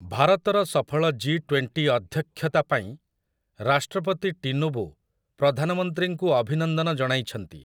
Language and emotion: Odia, neutral